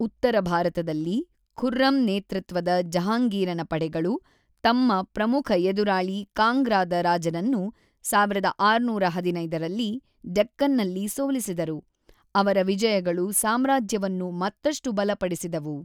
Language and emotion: Kannada, neutral